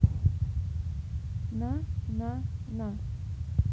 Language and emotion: Russian, neutral